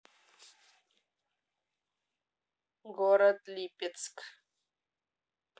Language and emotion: Russian, neutral